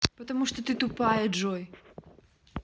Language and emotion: Russian, angry